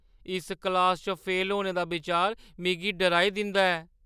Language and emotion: Dogri, fearful